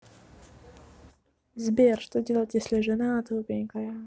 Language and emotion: Russian, neutral